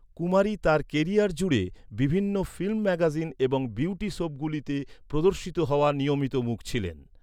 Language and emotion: Bengali, neutral